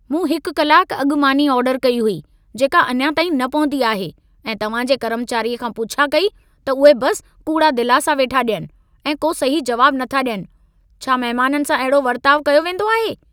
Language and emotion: Sindhi, angry